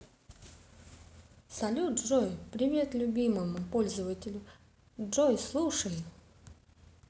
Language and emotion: Russian, positive